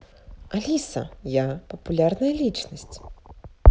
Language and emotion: Russian, positive